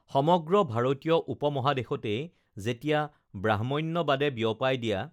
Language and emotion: Assamese, neutral